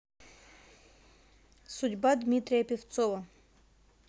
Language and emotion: Russian, neutral